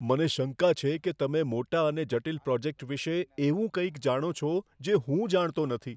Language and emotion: Gujarati, fearful